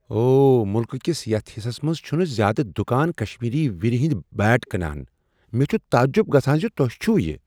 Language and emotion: Kashmiri, surprised